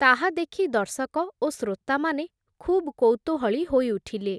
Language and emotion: Odia, neutral